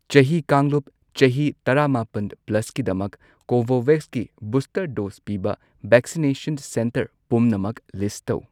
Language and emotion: Manipuri, neutral